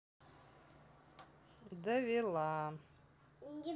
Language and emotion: Russian, sad